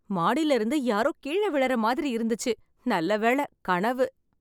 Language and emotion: Tamil, happy